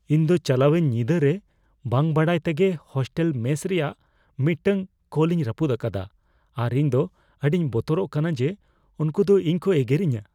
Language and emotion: Santali, fearful